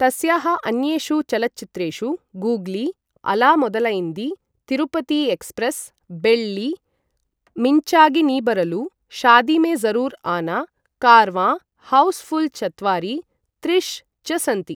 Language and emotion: Sanskrit, neutral